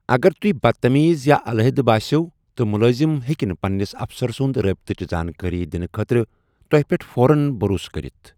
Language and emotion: Kashmiri, neutral